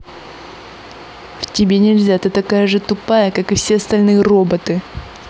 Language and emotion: Russian, angry